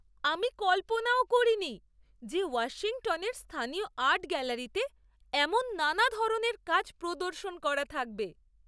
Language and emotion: Bengali, surprised